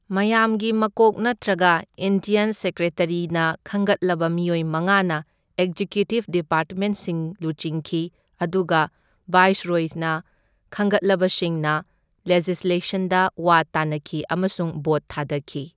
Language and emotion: Manipuri, neutral